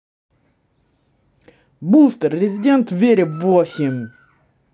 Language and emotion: Russian, neutral